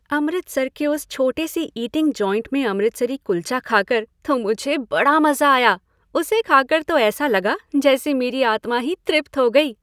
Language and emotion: Hindi, happy